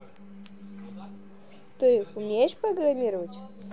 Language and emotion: Russian, positive